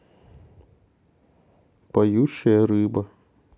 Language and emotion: Russian, sad